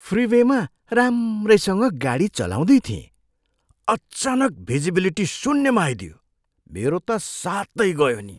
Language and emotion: Nepali, surprised